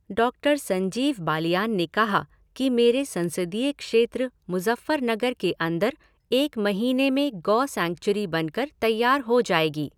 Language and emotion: Hindi, neutral